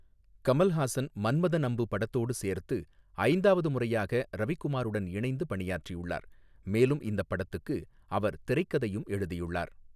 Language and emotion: Tamil, neutral